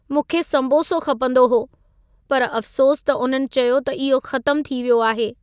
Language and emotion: Sindhi, sad